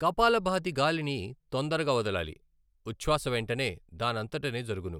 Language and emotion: Telugu, neutral